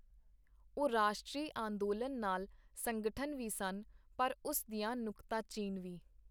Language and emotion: Punjabi, neutral